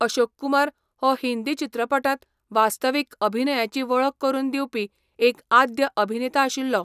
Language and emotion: Goan Konkani, neutral